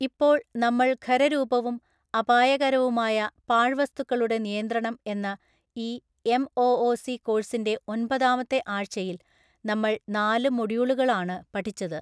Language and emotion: Malayalam, neutral